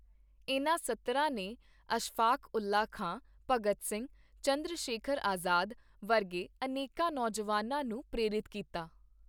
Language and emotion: Punjabi, neutral